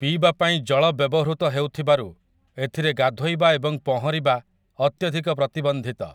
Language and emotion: Odia, neutral